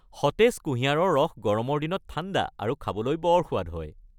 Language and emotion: Assamese, happy